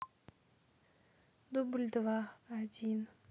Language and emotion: Russian, sad